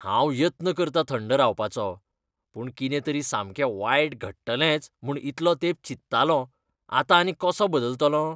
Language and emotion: Goan Konkani, disgusted